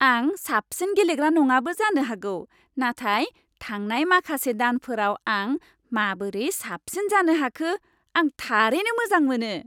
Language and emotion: Bodo, happy